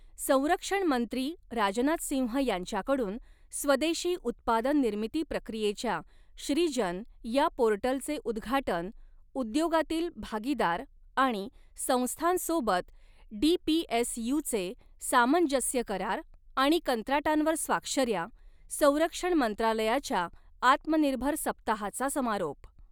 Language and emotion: Marathi, neutral